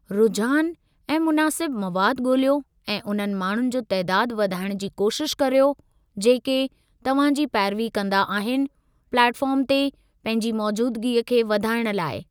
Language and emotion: Sindhi, neutral